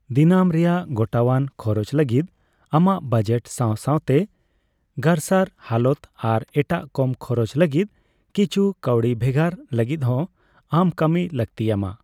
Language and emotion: Santali, neutral